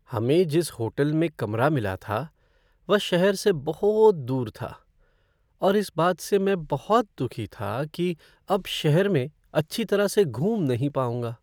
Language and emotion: Hindi, sad